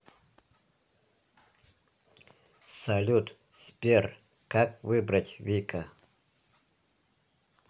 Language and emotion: Russian, neutral